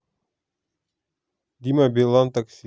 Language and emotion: Russian, neutral